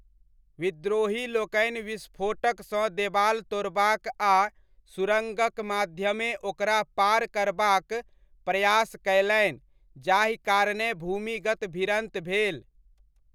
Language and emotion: Maithili, neutral